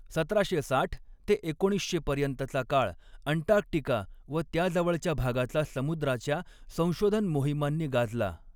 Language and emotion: Marathi, neutral